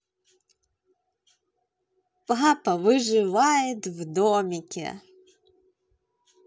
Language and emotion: Russian, positive